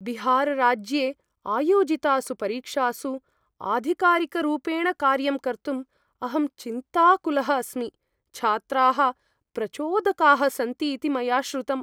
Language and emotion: Sanskrit, fearful